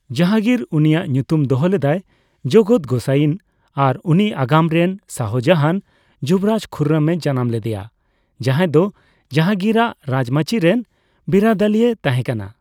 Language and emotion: Santali, neutral